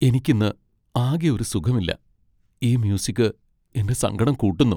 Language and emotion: Malayalam, sad